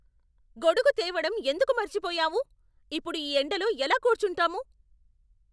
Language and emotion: Telugu, angry